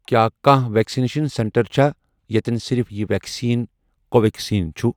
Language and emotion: Kashmiri, neutral